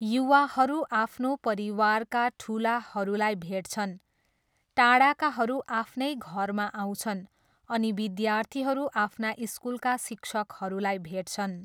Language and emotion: Nepali, neutral